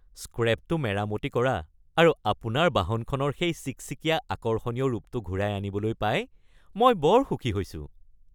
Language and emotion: Assamese, happy